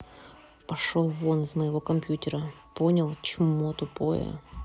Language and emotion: Russian, angry